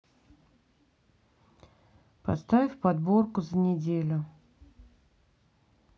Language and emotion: Russian, neutral